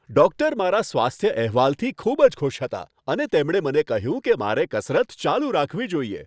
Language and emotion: Gujarati, happy